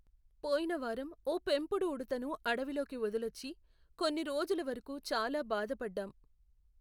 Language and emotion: Telugu, sad